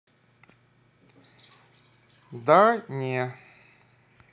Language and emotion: Russian, neutral